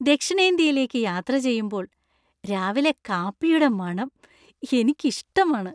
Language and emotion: Malayalam, happy